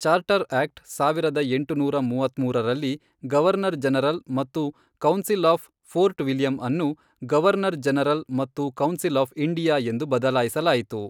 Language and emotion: Kannada, neutral